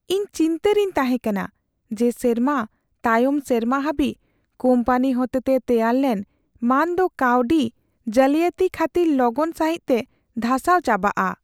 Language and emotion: Santali, fearful